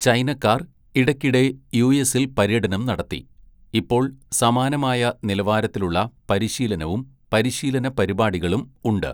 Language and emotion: Malayalam, neutral